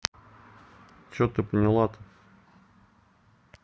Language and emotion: Russian, neutral